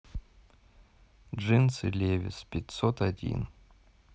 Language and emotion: Russian, neutral